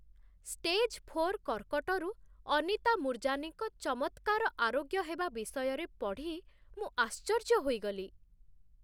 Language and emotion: Odia, surprised